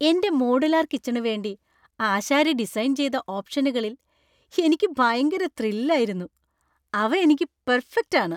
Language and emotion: Malayalam, happy